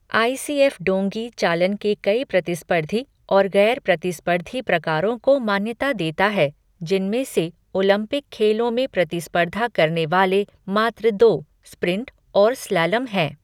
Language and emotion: Hindi, neutral